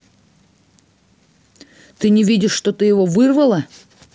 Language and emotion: Russian, angry